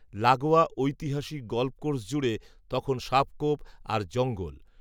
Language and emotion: Bengali, neutral